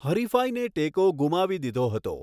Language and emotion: Gujarati, neutral